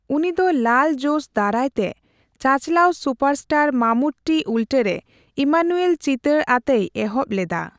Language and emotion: Santali, neutral